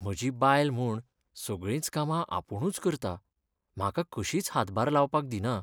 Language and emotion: Goan Konkani, sad